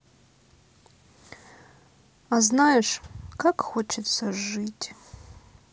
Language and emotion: Russian, sad